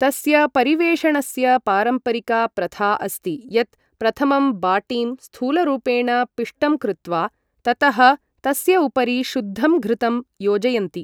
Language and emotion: Sanskrit, neutral